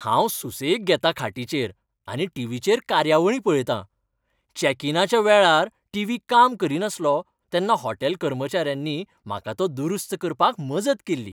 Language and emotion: Goan Konkani, happy